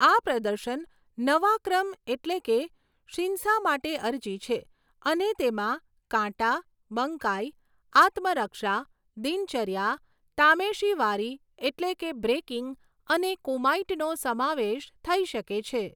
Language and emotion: Gujarati, neutral